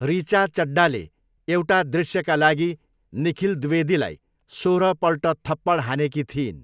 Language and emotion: Nepali, neutral